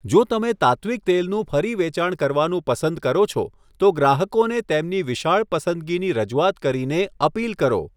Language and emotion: Gujarati, neutral